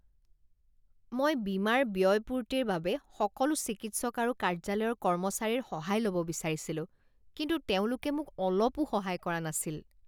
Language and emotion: Assamese, disgusted